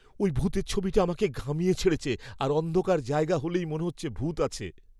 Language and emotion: Bengali, fearful